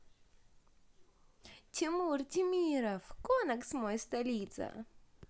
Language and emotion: Russian, positive